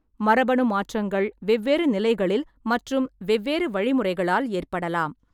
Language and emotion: Tamil, neutral